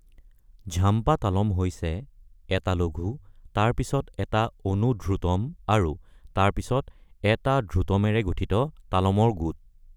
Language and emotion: Assamese, neutral